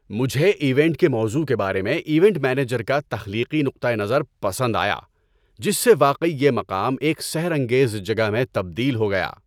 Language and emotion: Urdu, happy